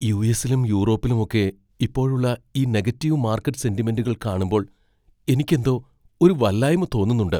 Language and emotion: Malayalam, fearful